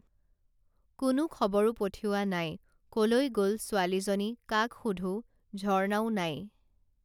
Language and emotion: Assamese, neutral